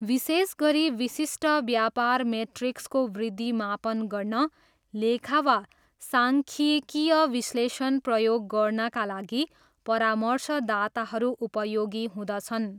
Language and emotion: Nepali, neutral